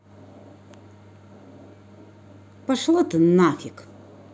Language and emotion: Russian, angry